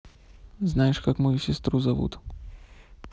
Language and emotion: Russian, neutral